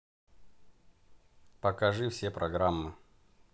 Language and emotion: Russian, neutral